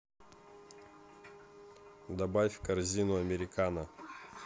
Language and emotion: Russian, neutral